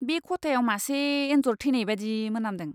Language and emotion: Bodo, disgusted